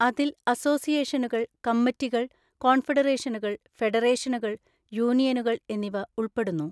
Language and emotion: Malayalam, neutral